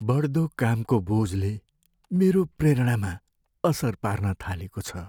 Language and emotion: Nepali, sad